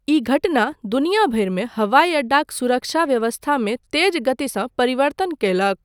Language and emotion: Maithili, neutral